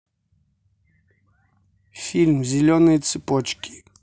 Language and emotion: Russian, neutral